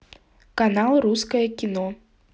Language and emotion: Russian, neutral